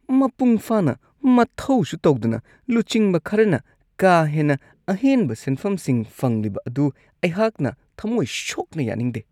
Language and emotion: Manipuri, disgusted